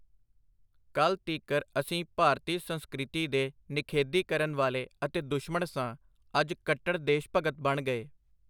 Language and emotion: Punjabi, neutral